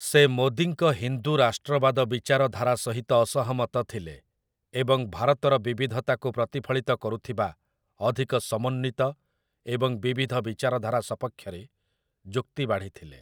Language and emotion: Odia, neutral